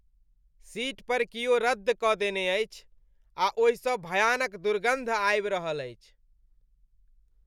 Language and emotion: Maithili, disgusted